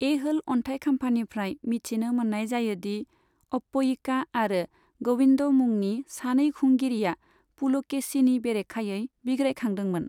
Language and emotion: Bodo, neutral